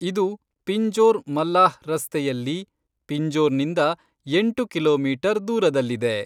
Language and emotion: Kannada, neutral